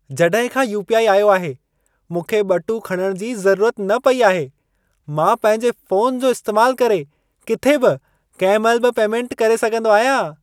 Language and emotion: Sindhi, happy